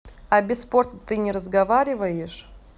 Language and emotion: Russian, neutral